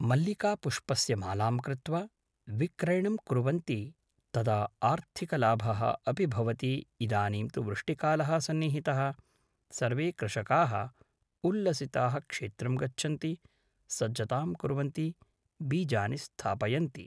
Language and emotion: Sanskrit, neutral